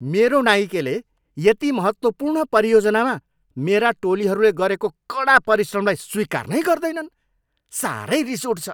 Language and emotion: Nepali, angry